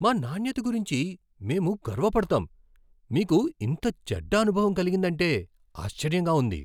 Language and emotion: Telugu, surprised